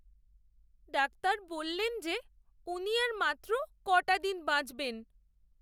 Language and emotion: Bengali, sad